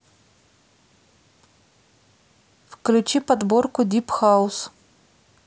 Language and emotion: Russian, neutral